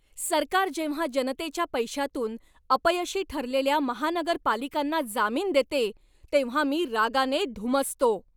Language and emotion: Marathi, angry